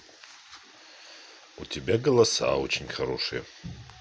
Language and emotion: Russian, neutral